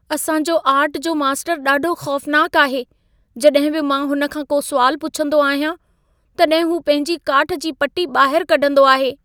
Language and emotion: Sindhi, fearful